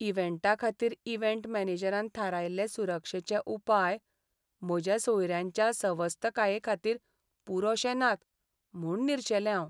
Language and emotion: Goan Konkani, sad